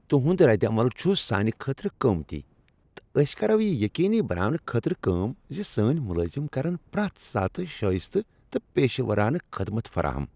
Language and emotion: Kashmiri, happy